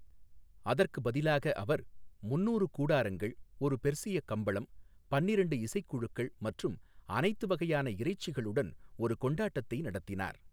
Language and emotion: Tamil, neutral